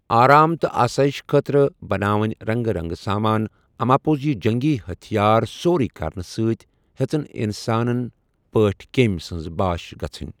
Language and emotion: Kashmiri, neutral